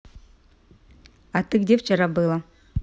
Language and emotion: Russian, positive